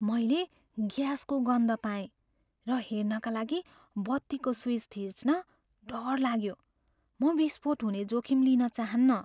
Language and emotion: Nepali, fearful